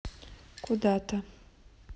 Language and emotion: Russian, neutral